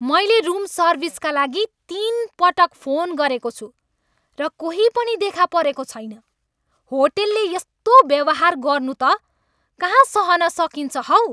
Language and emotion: Nepali, angry